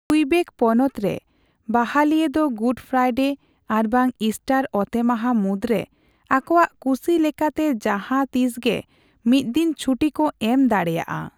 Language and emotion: Santali, neutral